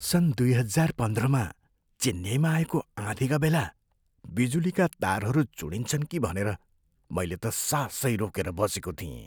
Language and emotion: Nepali, fearful